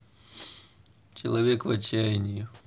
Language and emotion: Russian, sad